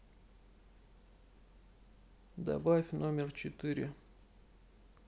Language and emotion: Russian, sad